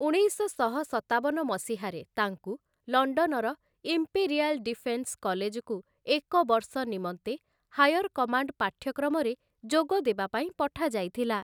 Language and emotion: Odia, neutral